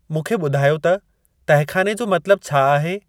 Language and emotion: Sindhi, neutral